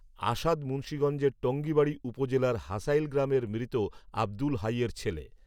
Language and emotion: Bengali, neutral